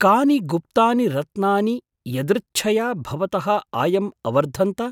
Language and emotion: Sanskrit, surprised